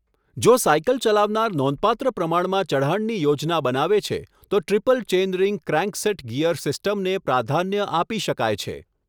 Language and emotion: Gujarati, neutral